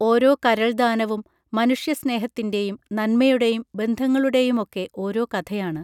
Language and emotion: Malayalam, neutral